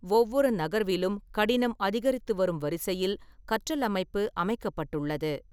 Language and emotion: Tamil, neutral